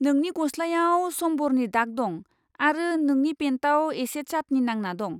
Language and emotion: Bodo, disgusted